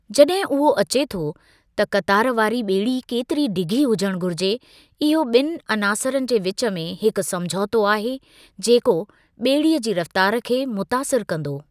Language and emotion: Sindhi, neutral